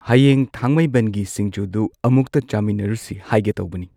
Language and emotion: Manipuri, neutral